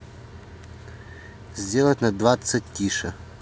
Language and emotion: Russian, neutral